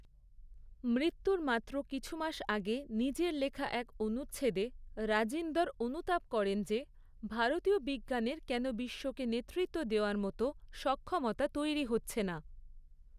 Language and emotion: Bengali, neutral